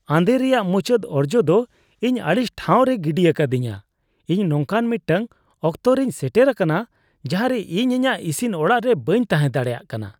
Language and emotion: Santali, disgusted